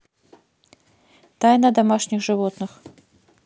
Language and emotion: Russian, neutral